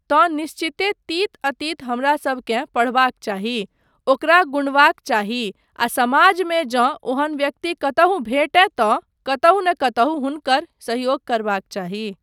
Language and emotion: Maithili, neutral